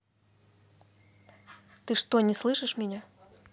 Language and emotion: Russian, angry